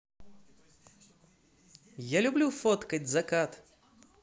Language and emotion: Russian, positive